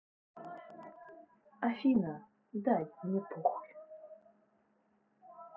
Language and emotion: Russian, neutral